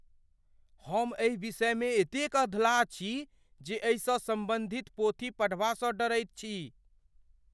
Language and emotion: Maithili, fearful